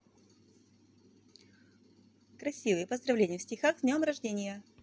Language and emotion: Russian, positive